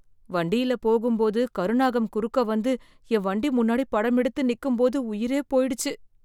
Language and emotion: Tamil, fearful